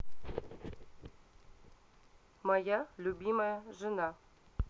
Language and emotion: Russian, neutral